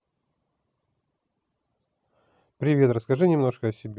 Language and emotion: Russian, neutral